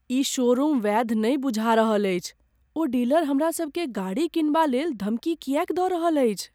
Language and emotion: Maithili, fearful